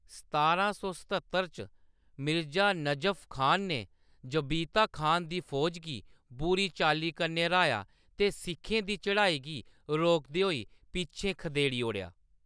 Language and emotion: Dogri, neutral